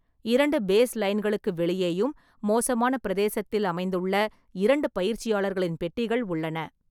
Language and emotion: Tamil, neutral